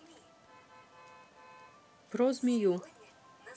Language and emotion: Russian, neutral